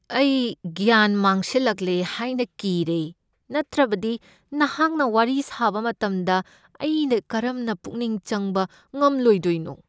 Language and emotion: Manipuri, fearful